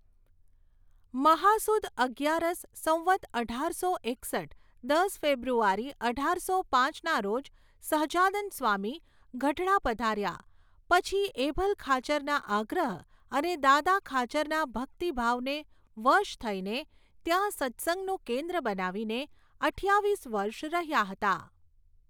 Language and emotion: Gujarati, neutral